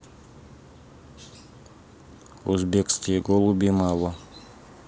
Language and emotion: Russian, neutral